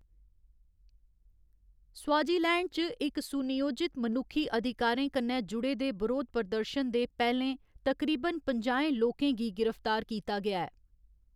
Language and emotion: Dogri, neutral